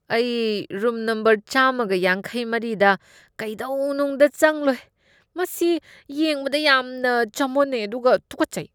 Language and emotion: Manipuri, disgusted